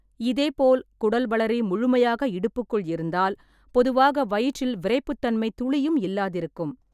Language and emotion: Tamil, neutral